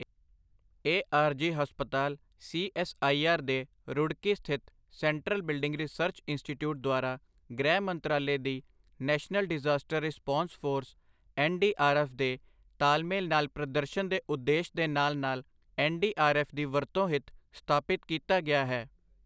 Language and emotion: Punjabi, neutral